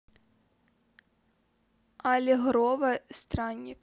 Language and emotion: Russian, neutral